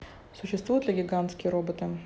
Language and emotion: Russian, neutral